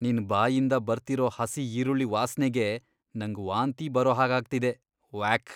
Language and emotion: Kannada, disgusted